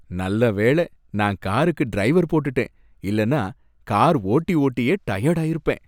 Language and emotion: Tamil, happy